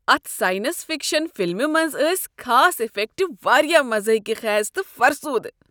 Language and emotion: Kashmiri, disgusted